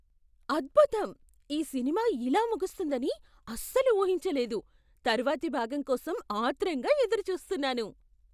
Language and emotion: Telugu, surprised